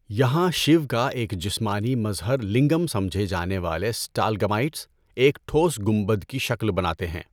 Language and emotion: Urdu, neutral